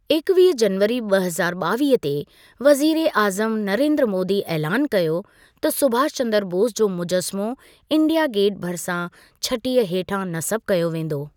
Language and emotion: Sindhi, neutral